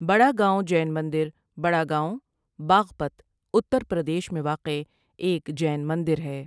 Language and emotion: Urdu, neutral